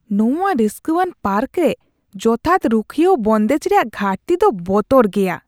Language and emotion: Santali, disgusted